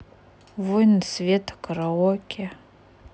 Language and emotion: Russian, neutral